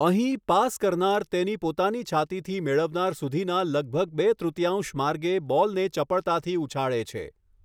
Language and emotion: Gujarati, neutral